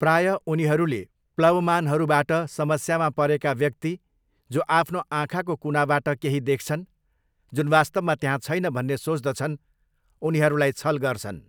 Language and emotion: Nepali, neutral